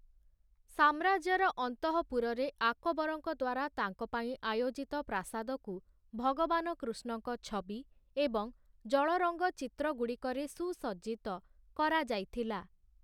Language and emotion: Odia, neutral